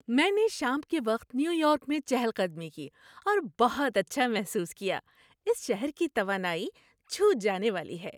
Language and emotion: Urdu, happy